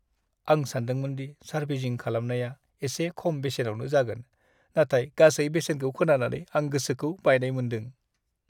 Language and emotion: Bodo, sad